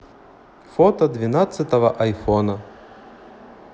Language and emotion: Russian, neutral